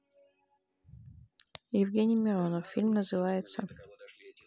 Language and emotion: Russian, neutral